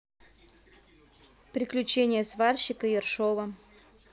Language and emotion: Russian, neutral